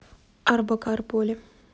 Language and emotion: Russian, neutral